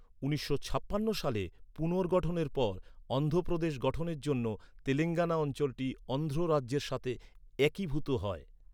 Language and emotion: Bengali, neutral